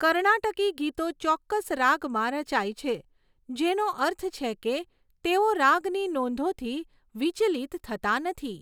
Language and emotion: Gujarati, neutral